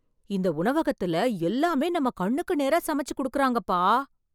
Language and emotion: Tamil, surprised